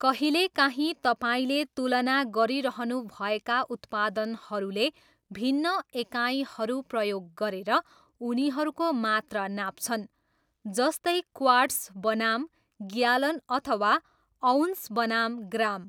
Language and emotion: Nepali, neutral